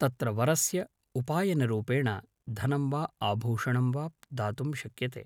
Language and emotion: Sanskrit, neutral